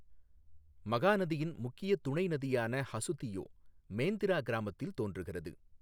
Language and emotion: Tamil, neutral